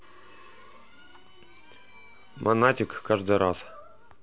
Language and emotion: Russian, neutral